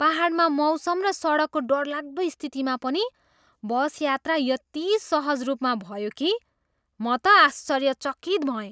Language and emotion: Nepali, surprised